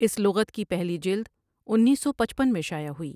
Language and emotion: Urdu, neutral